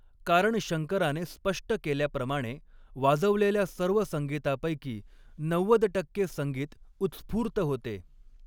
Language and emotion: Marathi, neutral